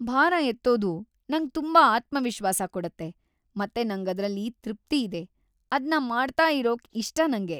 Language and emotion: Kannada, happy